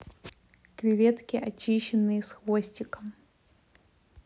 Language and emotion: Russian, neutral